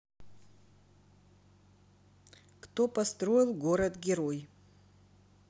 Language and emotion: Russian, neutral